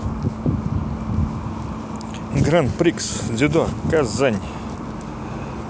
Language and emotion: Russian, neutral